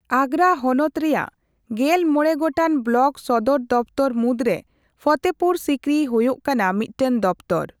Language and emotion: Santali, neutral